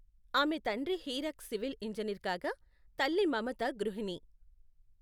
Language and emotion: Telugu, neutral